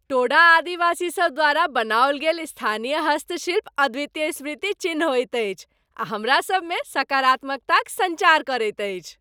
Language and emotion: Maithili, happy